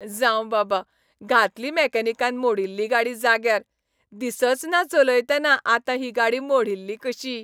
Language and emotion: Goan Konkani, happy